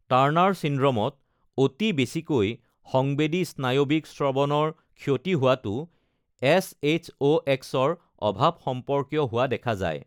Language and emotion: Assamese, neutral